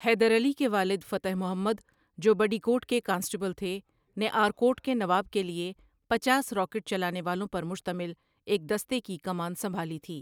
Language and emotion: Urdu, neutral